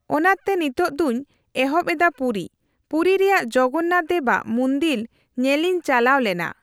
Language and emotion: Santali, neutral